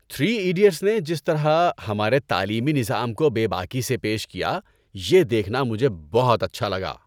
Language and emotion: Urdu, happy